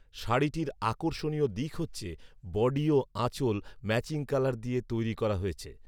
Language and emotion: Bengali, neutral